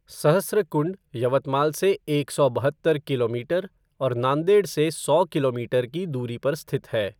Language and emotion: Hindi, neutral